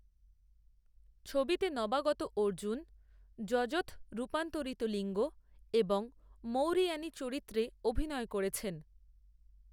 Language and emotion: Bengali, neutral